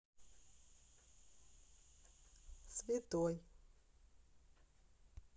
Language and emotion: Russian, neutral